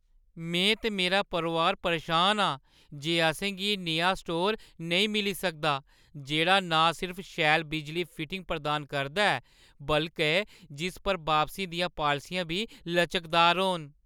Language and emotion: Dogri, sad